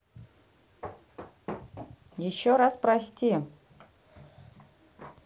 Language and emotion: Russian, neutral